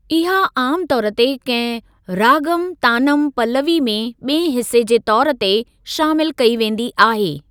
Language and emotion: Sindhi, neutral